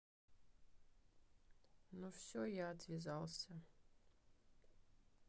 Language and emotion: Russian, sad